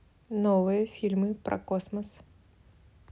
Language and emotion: Russian, neutral